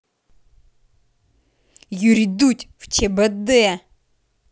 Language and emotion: Russian, angry